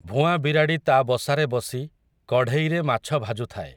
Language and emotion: Odia, neutral